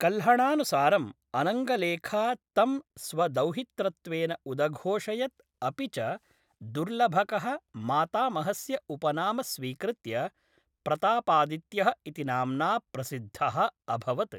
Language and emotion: Sanskrit, neutral